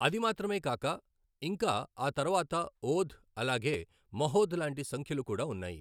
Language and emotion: Telugu, neutral